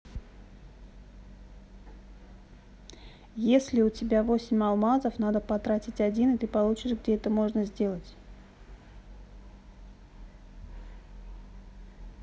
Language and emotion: Russian, neutral